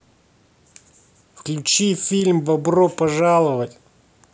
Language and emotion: Russian, angry